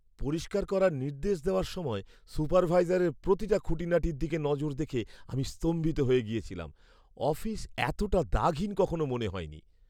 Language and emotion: Bengali, surprised